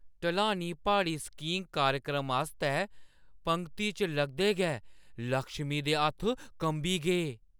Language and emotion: Dogri, fearful